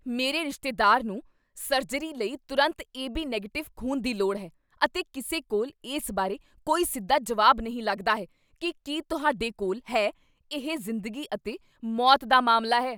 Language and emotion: Punjabi, angry